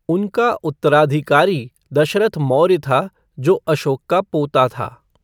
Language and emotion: Hindi, neutral